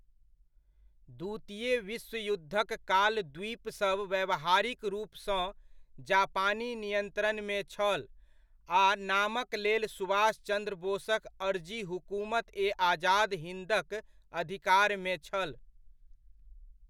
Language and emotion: Maithili, neutral